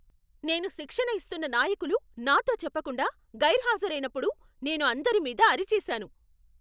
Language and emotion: Telugu, angry